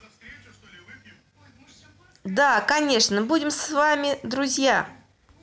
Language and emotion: Russian, positive